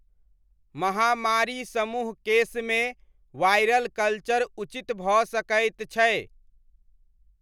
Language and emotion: Maithili, neutral